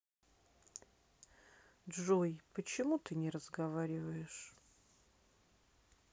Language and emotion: Russian, sad